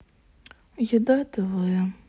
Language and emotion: Russian, sad